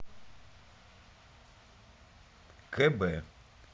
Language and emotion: Russian, neutral